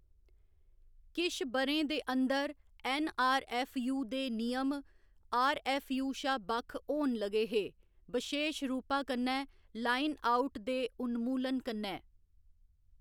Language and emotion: Dogri, neutral